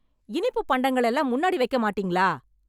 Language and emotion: Tamil, angry